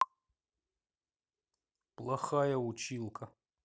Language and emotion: Russian, angry